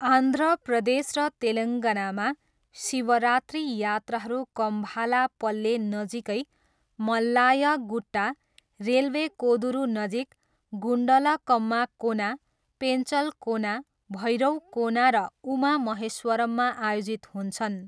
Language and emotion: Nepali, neutral